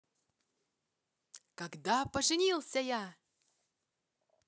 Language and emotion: Russian, positive